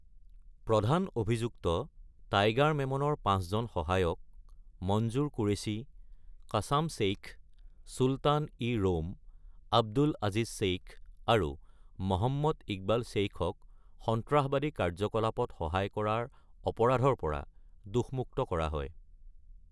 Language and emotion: Assamese, neutral